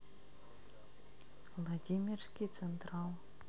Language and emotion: Russian, neutral